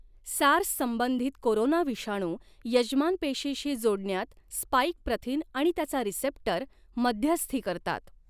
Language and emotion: Marathi, neutral